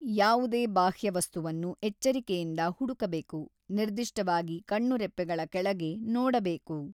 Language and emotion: Kannada, neutral